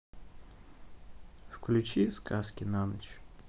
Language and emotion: Russian, neutral